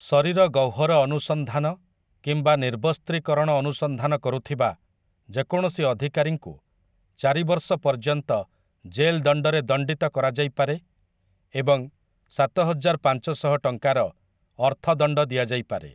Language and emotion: Odia, neutral